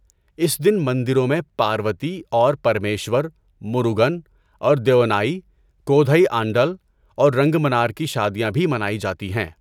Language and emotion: Urdu, neutral